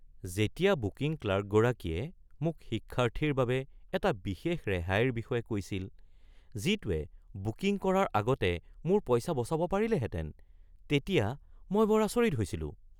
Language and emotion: Assamese, surprised